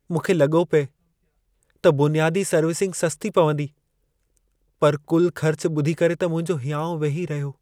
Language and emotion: Sindhi, sad